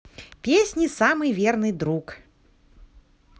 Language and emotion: Russian, positive